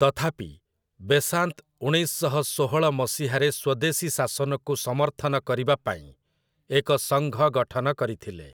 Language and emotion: Odia, neutral